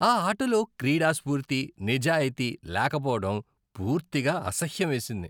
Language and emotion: Telugu, disgusted